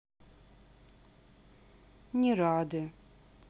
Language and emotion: Russian, sad